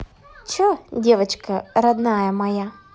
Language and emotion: Russian, positive